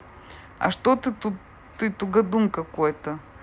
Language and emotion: Russian, neutral